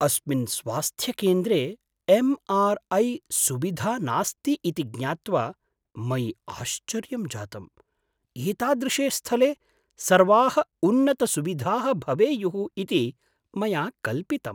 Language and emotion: Sanskrit, surprised